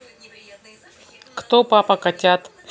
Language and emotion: Russian, neutral